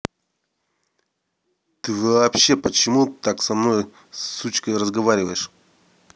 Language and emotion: Russian, angry